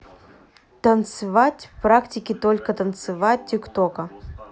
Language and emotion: Russian, neutral